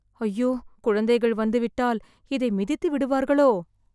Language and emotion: Tamil, fearful